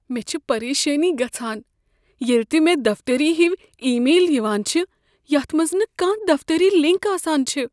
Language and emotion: Kashmiri, fearful